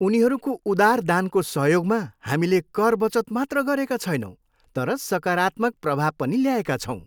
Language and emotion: Nepali, happy